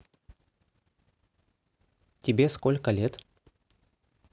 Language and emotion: Russian, neutral